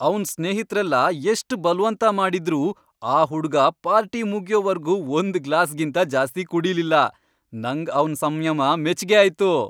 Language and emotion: Kannada, happy